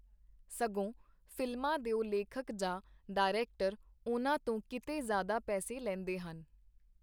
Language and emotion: Punjabi, neutral